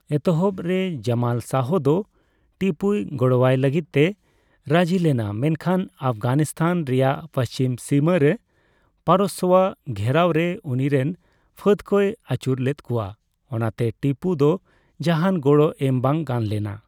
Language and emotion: Santali, neutral